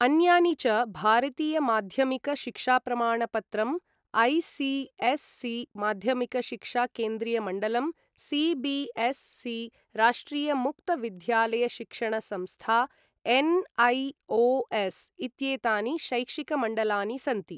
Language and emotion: Sanskrit, neutral